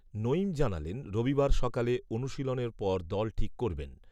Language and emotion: Bengali, neutral